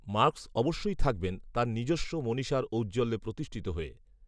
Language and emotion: Bengali, neutral